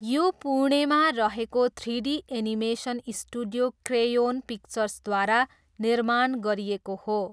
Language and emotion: Nepali, neutral